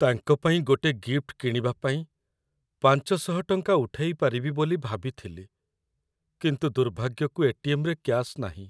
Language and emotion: Odia, sad